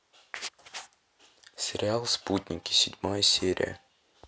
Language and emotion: Russian, neutral